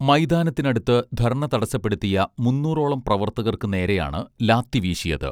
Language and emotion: Malayalam, neutral